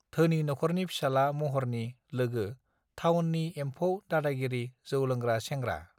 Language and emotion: Bodo, neutral